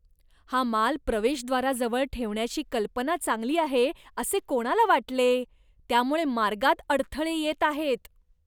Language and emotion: Marathi, disgusted